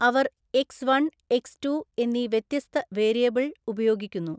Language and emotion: Malayalam, neutral